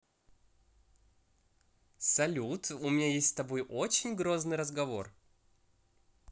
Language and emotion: Russian, positive